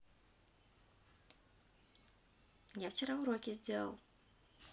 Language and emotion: Russian, neutral